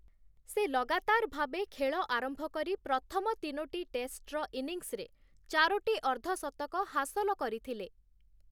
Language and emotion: Odia, neutral